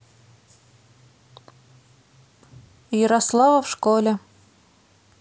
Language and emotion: Russian, neutral